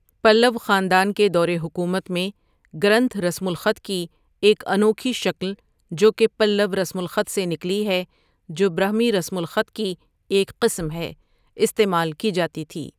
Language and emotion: Urdu, neutral